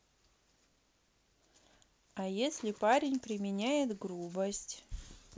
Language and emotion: Russian, neutral